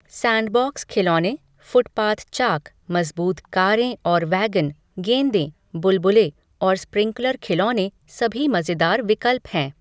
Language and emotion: Hindi, neutral